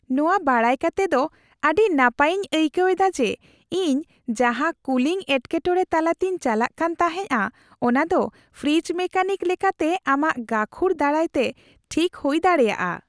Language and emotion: Santali, happy